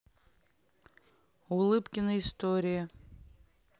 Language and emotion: Russian, neutral